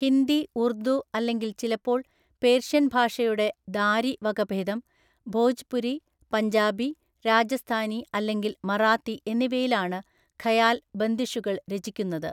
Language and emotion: Malayalam, neutral